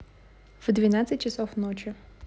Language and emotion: Russian, neutral